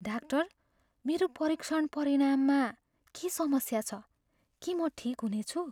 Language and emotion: Nepali, fearful